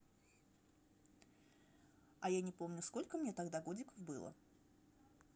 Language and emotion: Russian, neutral